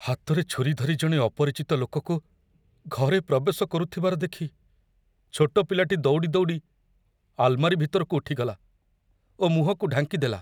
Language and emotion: Odia, fearful